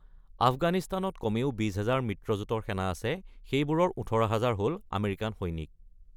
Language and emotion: Assamese, neutral